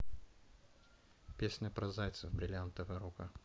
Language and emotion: Russian, neutral